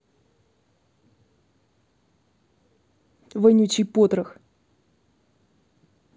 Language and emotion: Russian, angry